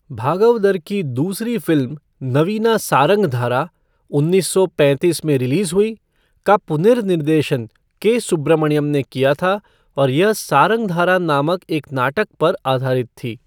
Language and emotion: Hindi, neutral